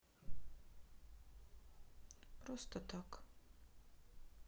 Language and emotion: Russian, sad